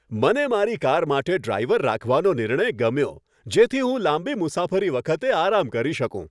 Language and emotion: Gujarati, happy